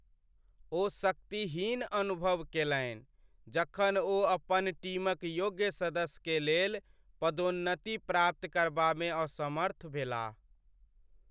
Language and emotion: Maithili, sad